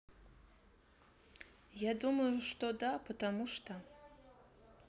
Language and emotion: Russian, neutral